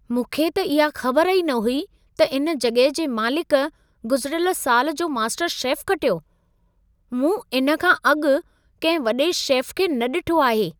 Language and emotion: Sindhi, surprised